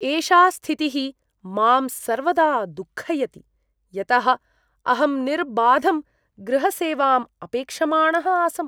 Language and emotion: Sanskrit, disgusted